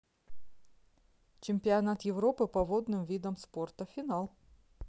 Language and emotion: Russian, neutral